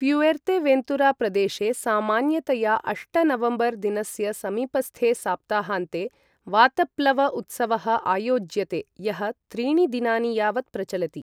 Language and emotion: Sanskrit, neutral